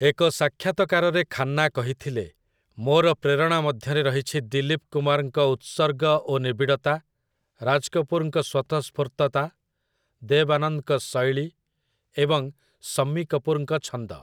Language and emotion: Odia, neutral